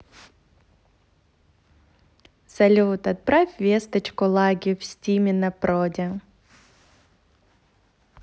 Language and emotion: Russian, positive